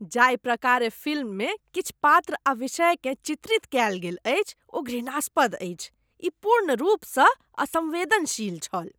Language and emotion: Maithili, disgusted